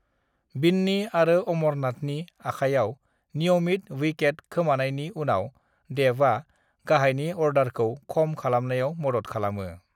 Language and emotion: Bodo, neutral